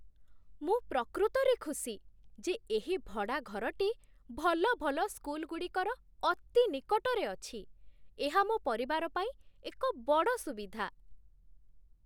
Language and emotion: Odia, surprised